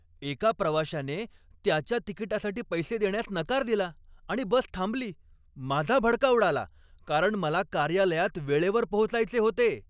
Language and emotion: Marathi, angry